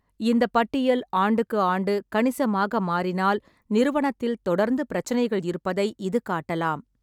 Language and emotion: Tamil, neutral